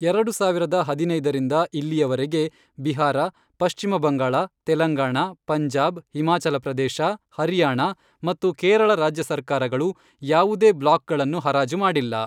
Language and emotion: Kannada, neutral